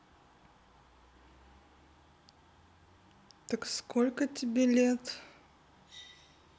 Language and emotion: Russian, neutral